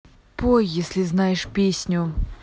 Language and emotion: Russian, angry